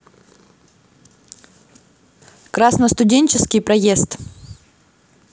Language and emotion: Russian, neutral